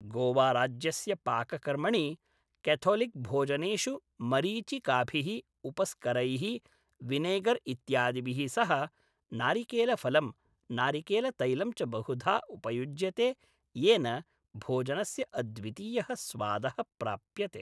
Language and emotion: Sanskrit, neutral